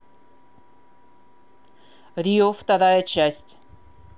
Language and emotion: Russian, neutral